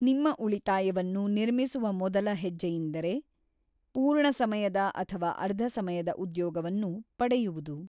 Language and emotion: Kannada, neutral